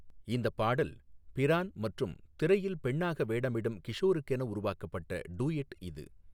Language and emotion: Tamil, neutral